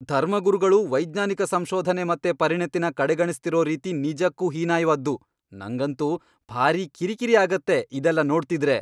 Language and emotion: Kannada, angry